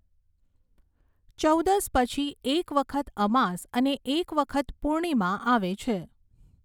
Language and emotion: Gujarati, neutral